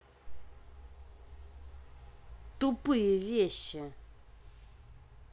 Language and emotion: Russian, angry